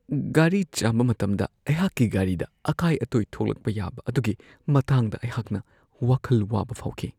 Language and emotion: Manipuri, fearful